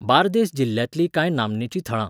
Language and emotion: Goan Konkani, neutral